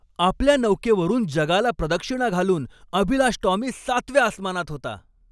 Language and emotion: Marathi, happy